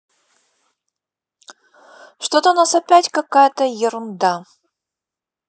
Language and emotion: Russian, neutral